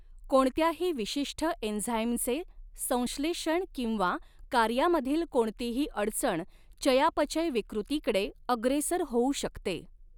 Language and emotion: Marathi, neutral